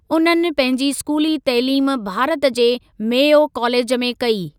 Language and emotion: Sindhi, neutral